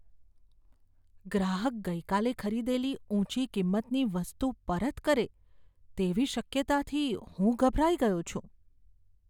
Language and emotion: Gujarati, fearful